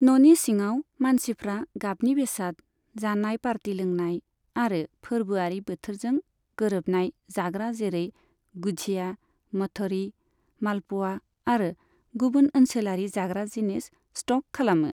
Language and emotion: Bodo, neutral